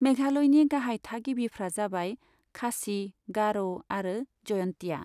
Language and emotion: Bodo, neutral